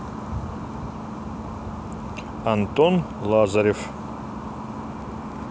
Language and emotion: Russian, neutral